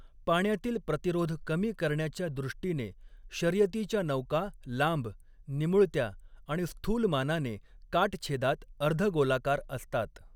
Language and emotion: Marathi, neutral